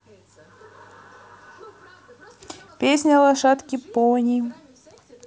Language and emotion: Russian, positive